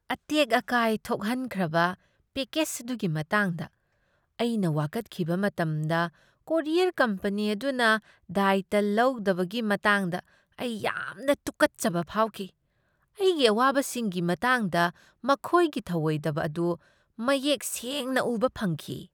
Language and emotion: Manipuri, disgusted